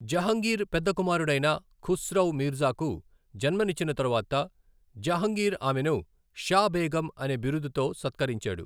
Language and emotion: Telugu, neutral